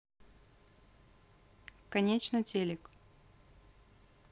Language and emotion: Russian, neutral